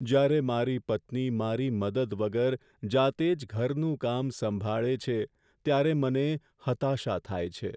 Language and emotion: Gujarati, sad